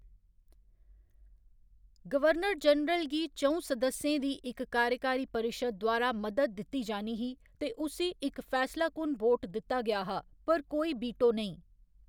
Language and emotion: Dogri, neutral